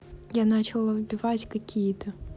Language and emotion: Russian, neutral